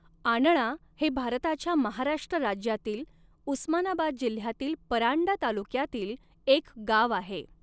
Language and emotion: Marathi, neutral